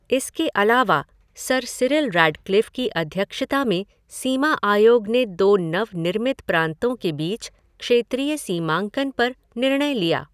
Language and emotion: Hindi, neutral